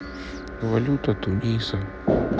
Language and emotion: Russian, sad